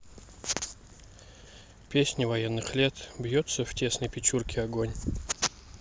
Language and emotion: Russian, neutral